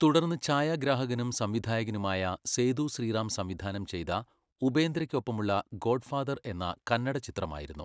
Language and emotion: Malayalam, neutral